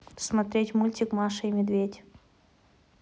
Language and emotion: Russian, neutral